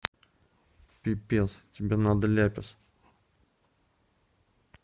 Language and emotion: Russian, neutral